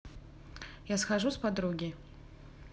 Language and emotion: Russian, neutral